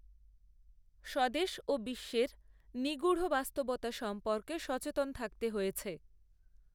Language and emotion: Bengali, neutral